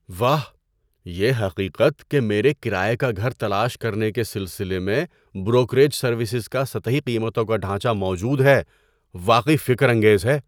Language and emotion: Urdu, surprised